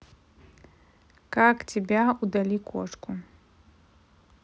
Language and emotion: Russian, neutral